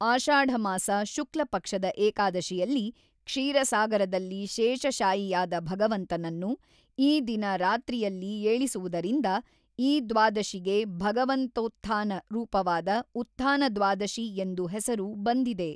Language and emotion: Kannada, neutral